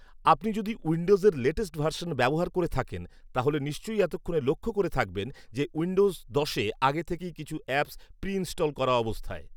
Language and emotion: Bengali, neutral